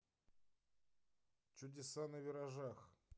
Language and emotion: Russian, neutral